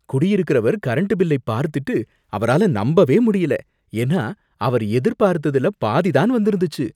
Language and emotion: Tamil, surprised